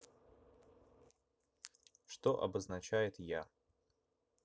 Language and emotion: Russian, neutral